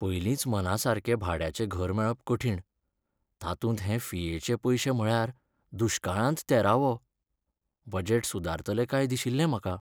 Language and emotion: Goan Konkani, sad